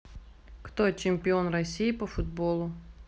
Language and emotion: Russian, neutral